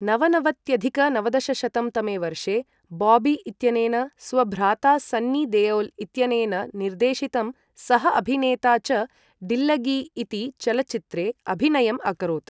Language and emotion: Sanskrit, neutral